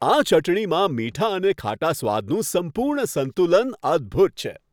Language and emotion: Gujarati, happy